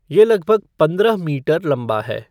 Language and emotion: Hindi, neutral